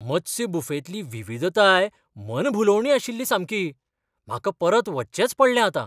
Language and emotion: Goan Konkani, surprised